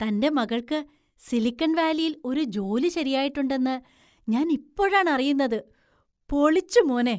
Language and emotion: Malayalam, surprised